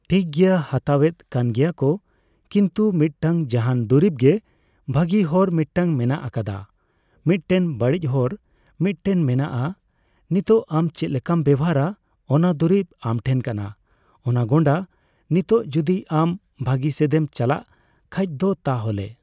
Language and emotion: Santali, neutral